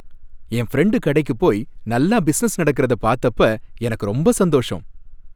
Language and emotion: Tamil, happy